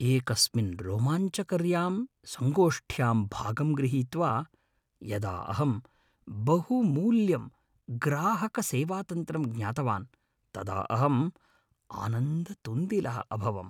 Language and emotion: Sanskrit, happy